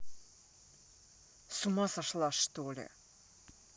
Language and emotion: Russian, angry